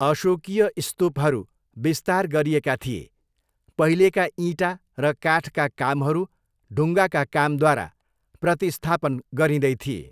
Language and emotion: Nepali, neutral